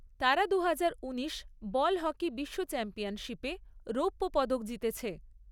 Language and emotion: Bengali, neutral